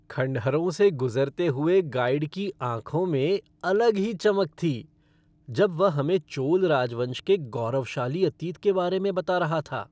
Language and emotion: Hindi, happy